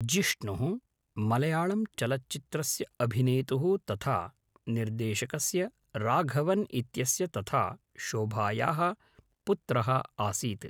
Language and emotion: Sanskrit, neutral